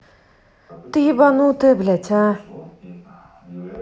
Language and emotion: Russian, angry